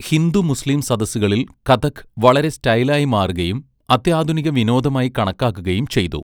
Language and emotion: Malayalam, neutral